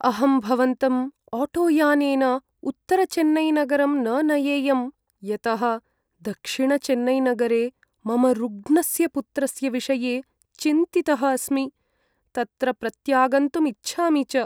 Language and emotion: Sanskrit, sad